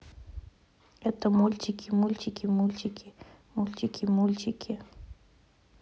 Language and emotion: Russian, neutral